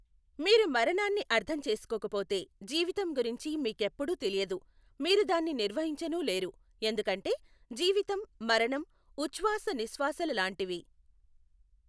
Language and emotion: Telugu, neutral